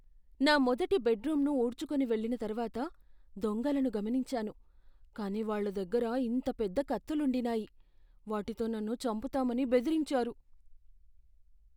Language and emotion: Telugu, fearful